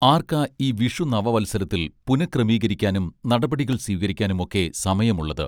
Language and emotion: Malayalam, neutral